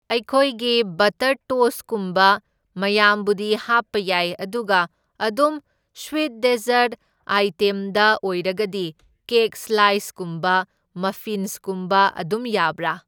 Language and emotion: Manipuri, neutral